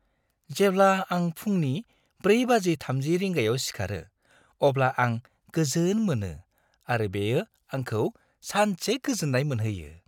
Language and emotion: Bodo, happy